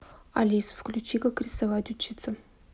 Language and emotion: Russian, neutral